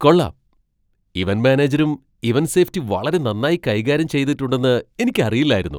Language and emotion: Malayalam, surprised